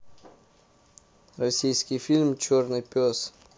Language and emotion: Russian, neutral